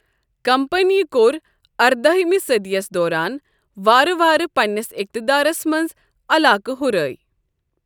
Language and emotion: Kashmiri, neutral